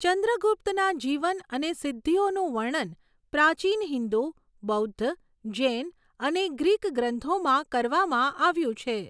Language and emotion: Gujarati, neutral